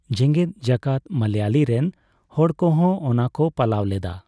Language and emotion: Santali, neutral